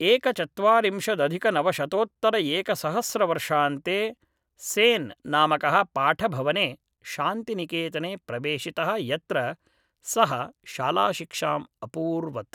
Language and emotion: Sanskrit, neutral